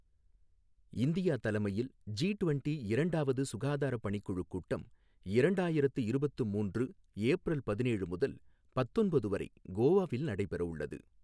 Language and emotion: Tamil, neutral